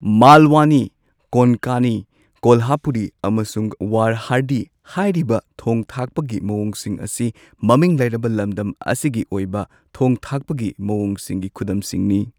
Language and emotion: Manipuri, neutral